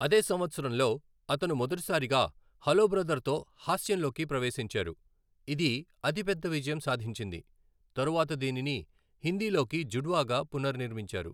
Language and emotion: Telugu, neutral